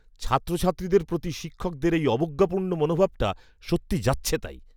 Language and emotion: Bengali, disgusted